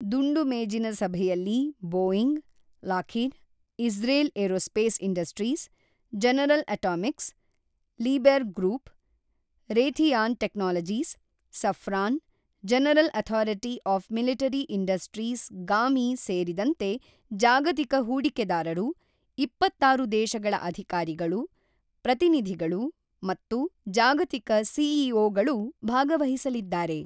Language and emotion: Kannada, neutral